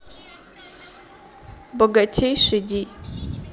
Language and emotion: Russian, neutral